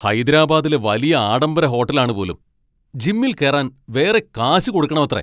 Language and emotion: Malayalam, angry